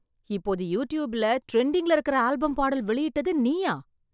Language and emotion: Tamil, surprised